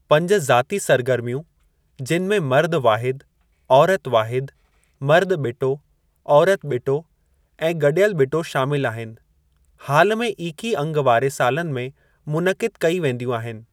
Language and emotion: Sindhi, neutral